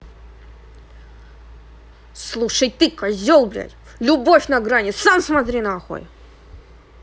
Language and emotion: Russian, angry